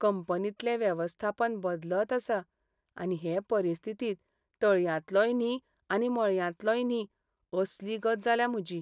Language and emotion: Goan Konkani, sad